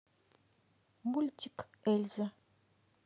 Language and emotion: Russian, neutral